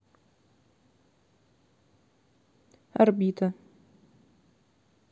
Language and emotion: Russian, neutral